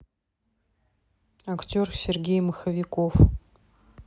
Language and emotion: Russian, neutral